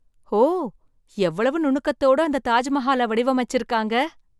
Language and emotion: Tamil, surprised